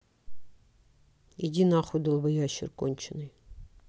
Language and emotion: Russian, angry